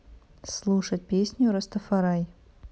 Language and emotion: Russian, neutral